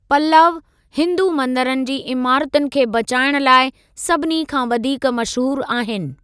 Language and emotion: Sindhi, neutral